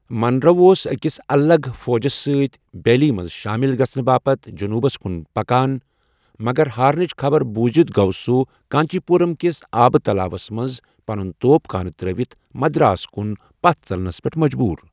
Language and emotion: Kashmiri, neutral